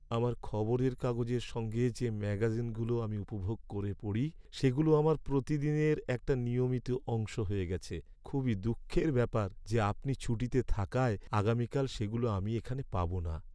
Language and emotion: Bengali, sad